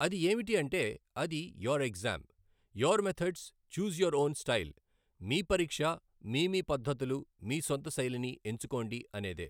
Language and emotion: Telugu, neutral